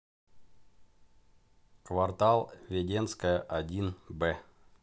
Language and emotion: Russian, neutral